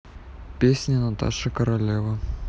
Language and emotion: Russian, neutral